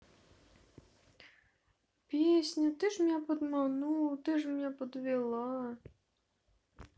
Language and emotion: Russian, sad